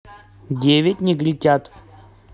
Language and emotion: Russian, neutral